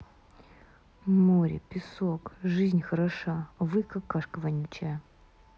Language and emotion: Russian, angry